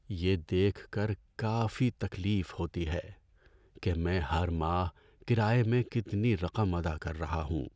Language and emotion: Urdu, sad